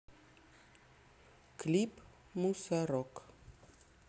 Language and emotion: Russian, neutral